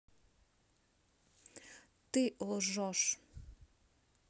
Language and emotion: Russian, neutral